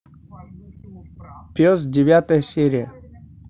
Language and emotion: Russian, neutral